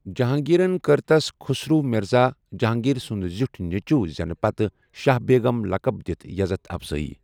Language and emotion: Kashmiri, neutral